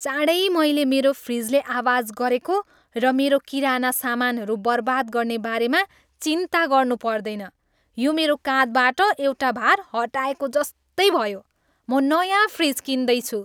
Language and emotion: Nepali, happy